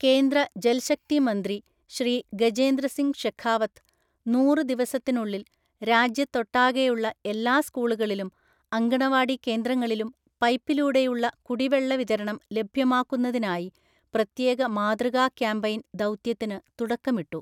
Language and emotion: Malayalam, neutral